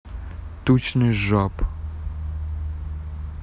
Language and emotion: Russian, neutral